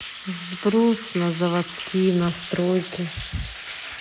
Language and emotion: Russian, sad